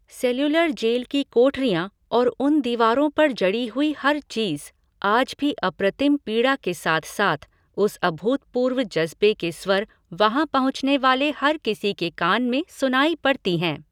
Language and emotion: Hindi, neutral